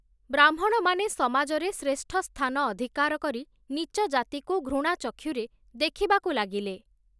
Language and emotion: Odia, neutral